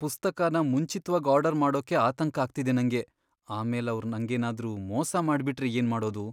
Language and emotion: Kannada, fearful